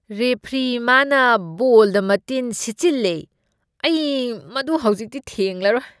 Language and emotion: Manipuri, disgusted